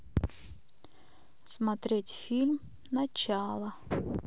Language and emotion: Russian, neutral